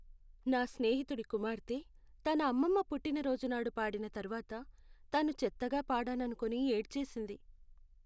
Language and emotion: Telugu, sad